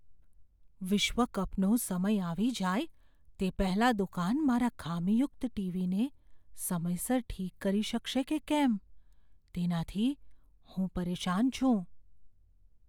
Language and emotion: Gujarati, fearful